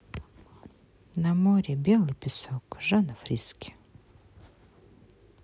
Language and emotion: Russian, sad